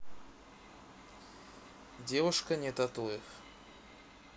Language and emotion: Russian, neutral